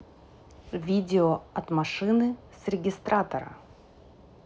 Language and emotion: Russian, neutral